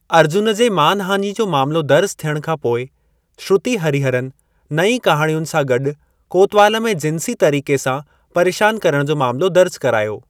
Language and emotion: Sindhi, neutral